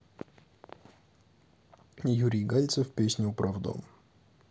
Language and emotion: Russian, neutral